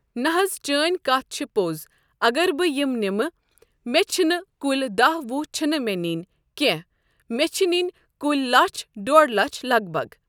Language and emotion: Kashmiri, neutral